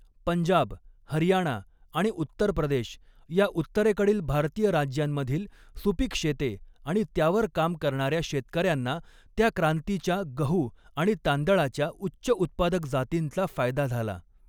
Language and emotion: Marathi, neutral